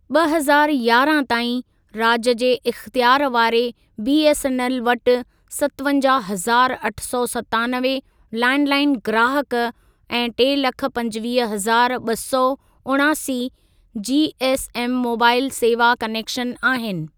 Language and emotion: Sindhi, neutral